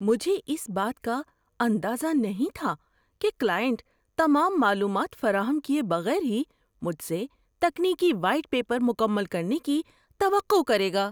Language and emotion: Urdu, surprised